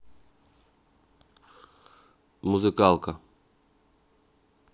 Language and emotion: Russian, neutral